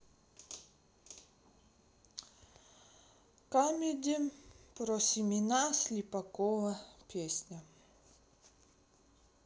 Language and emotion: Russian, sad